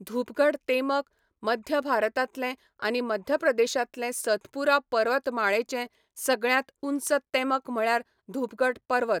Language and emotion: Goan Konkani, neutral